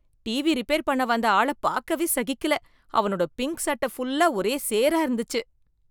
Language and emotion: Tamil, disgusted